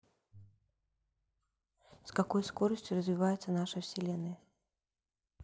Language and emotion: Russian, neutral